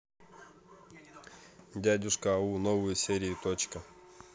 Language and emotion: Russian, neutral